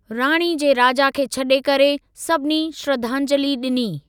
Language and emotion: Sindhi, neutral